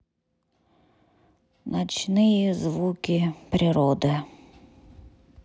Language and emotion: Russian, neutral